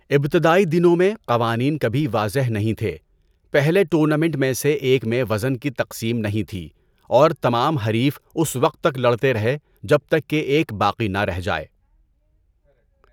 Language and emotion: Urdu, neutral